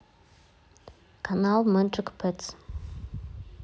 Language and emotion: Russian, neutral